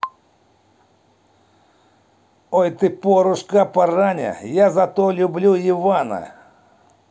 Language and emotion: Russian, positive